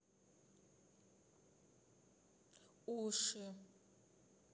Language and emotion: Russian, neutral